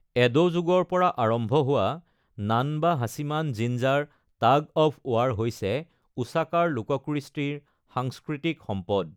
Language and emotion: Assamese, neutral